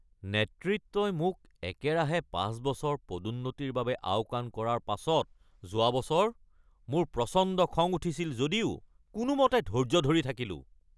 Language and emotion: Assamese, angry